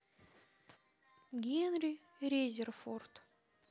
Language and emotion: Russian, neutral